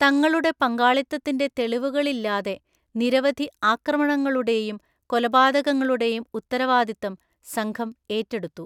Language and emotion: Malayalam, neutral